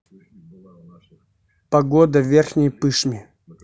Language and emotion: Russian, neutral